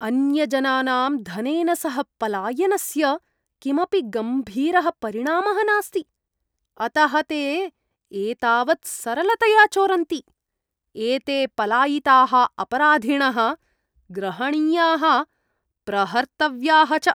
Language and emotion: Sanskrit, disgusted